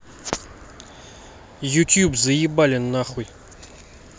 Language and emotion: Russian, angry